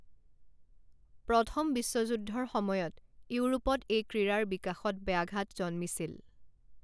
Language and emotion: Assamese, neutral